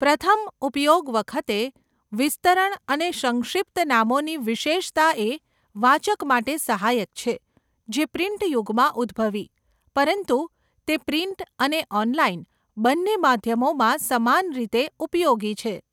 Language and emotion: Gujarati, neutral